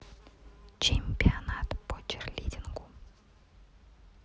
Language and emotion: Russian, neutral